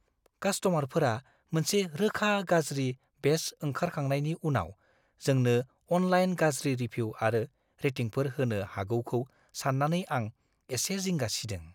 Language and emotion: Bodo, fearful